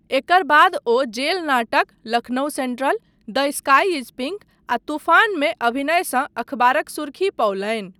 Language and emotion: Maithili, neutral